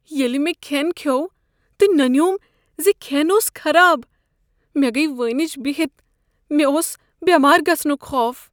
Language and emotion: Kashmiri, fearful